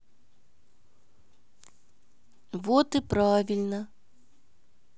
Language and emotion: Russian, sad